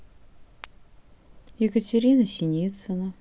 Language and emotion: Russian, neutral